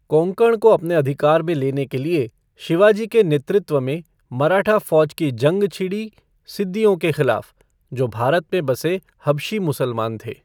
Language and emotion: Hindi, neutral